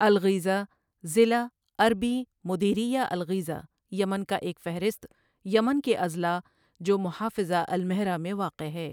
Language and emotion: Urdu, neutral